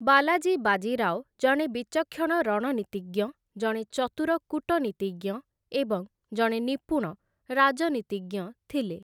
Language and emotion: Odia, neutral